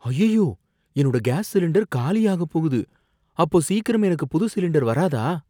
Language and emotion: Tamil, fearful